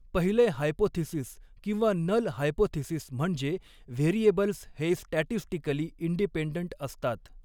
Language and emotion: Marathi, neutral